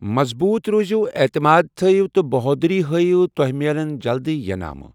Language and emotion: Kashmiri, neutral